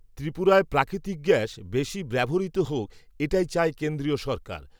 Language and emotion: Bengali, neutral